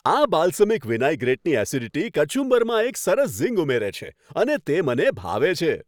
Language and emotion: Gujarati, happy